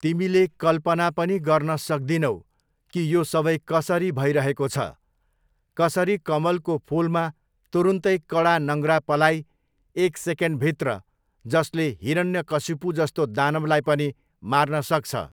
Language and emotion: Nepali, neutral